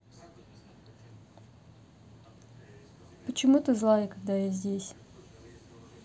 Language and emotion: Russian, neutral